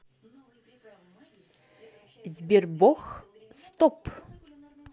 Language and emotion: Russian, neutral